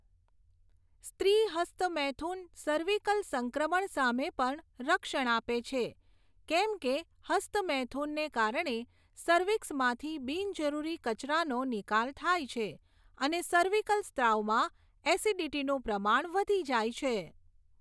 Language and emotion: Gujarati, neutral